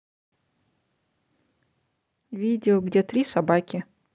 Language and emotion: Russian, neutral